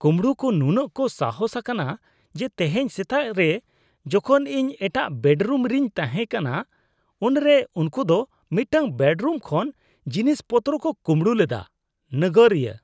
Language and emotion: Santali, disgusted